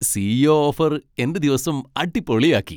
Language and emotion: Malayalam, happy